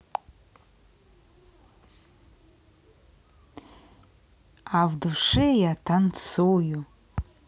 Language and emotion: Russian, positive